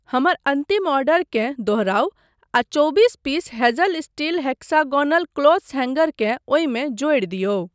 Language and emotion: Maithili, neutral